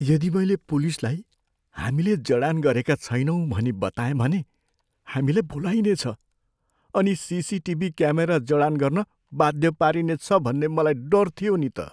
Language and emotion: Nepali, fearful